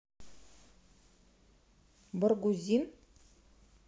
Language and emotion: Russian, neutral